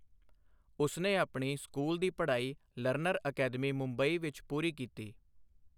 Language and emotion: Punjabi, neutral